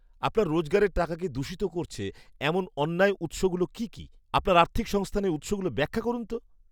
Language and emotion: Bengali, disgusted